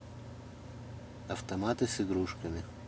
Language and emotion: Russian, neutral